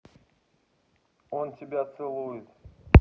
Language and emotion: Russian, neutral